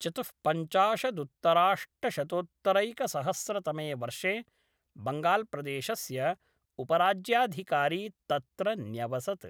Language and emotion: Sanskrit, neutral